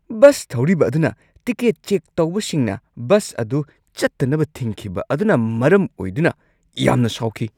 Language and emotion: Manipuri, angry